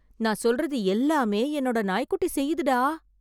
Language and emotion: Tamil, surprised